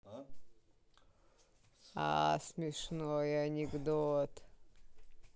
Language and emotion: Russian, neutral